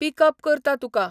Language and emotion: Goan Konkani, neutral